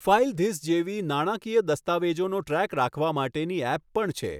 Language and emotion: Gujarati, neutral